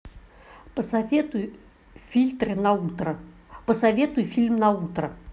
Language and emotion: Russian, neutral